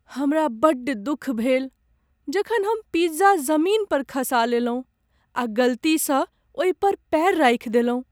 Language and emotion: Maithili, sad